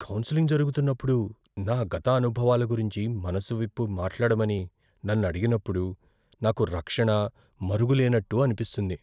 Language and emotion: Telugu, fearful